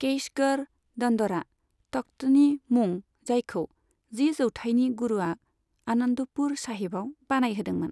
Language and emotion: Bodo, neutral